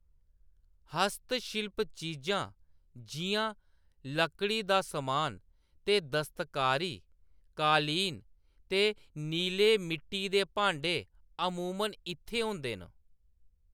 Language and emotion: Dogri, neutral